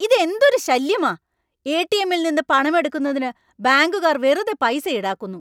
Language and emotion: Malayalam, angry